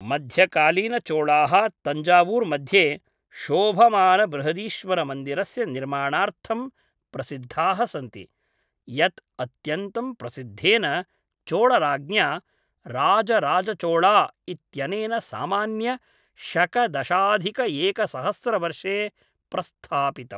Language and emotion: Sanskrit, neutral